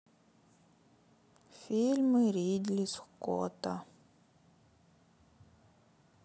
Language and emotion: Russian, sad